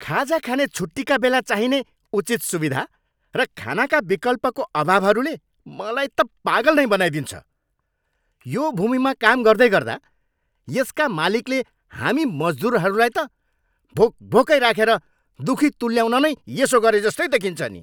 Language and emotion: Nepali, angry